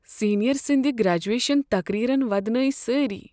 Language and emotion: Kashmiri, sad